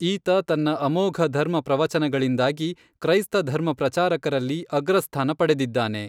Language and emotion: Kannada, neutral